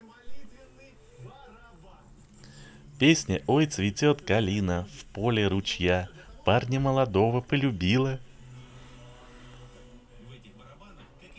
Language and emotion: Russian, positive